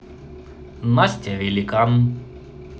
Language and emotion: Russian, neutral